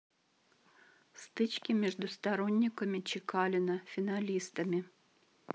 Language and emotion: Russian, neutral